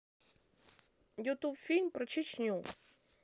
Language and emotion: Russian, neutral